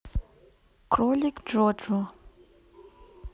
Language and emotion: Russian, neutral